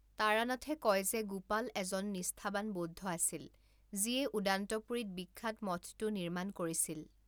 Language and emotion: Assamese, neutral